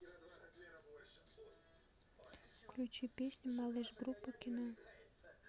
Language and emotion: Russian, neutral